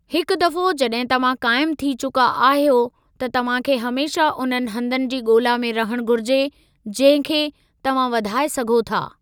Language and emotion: Sindhi, neutral